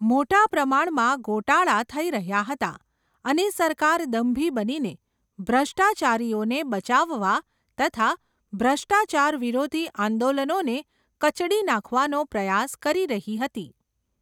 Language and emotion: Gujarati, neutral